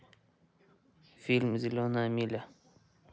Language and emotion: Russian, neutral